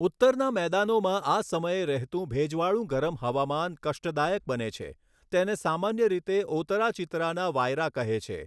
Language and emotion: Gujarati, neutral